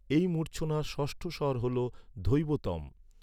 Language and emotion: Bengali, neutral